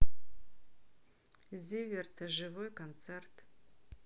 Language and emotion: Russian, neutral